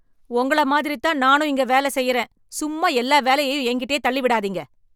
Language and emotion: Tamil, angry